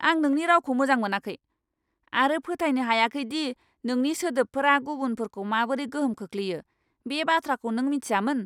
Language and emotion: Bodo, angry